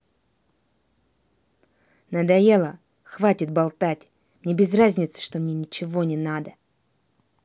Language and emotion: Russian, angry